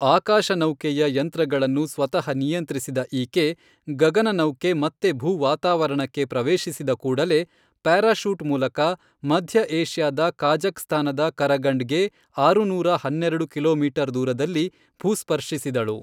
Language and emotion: Kannada, neutral